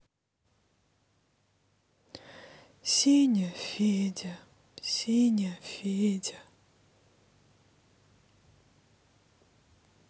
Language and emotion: Russian, sad